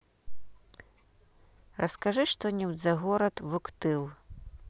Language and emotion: Russian, neutral